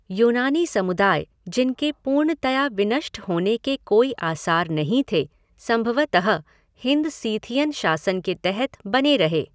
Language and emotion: Hindi, neutral